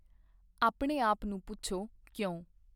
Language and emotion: Punjabi, neutral